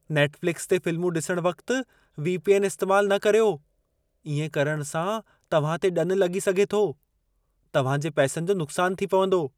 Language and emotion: Sindhi, fearful